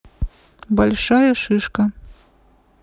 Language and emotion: Russian, neutral